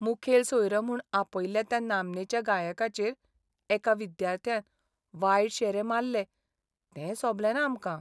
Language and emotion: Goan Konkani, sad